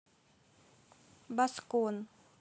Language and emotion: Russian, neutral